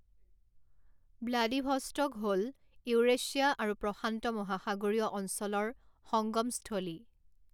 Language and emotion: Assamese, neutral